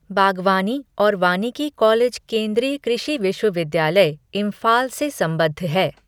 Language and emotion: Hindi, neutral